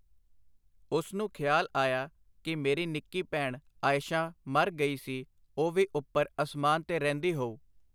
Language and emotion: Punjabi, neutral